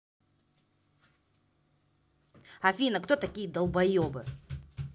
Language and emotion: Russian, angry